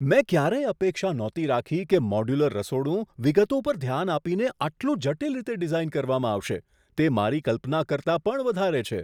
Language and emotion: Gujarati, surprised